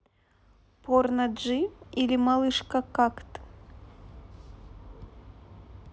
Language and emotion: Russian, neutral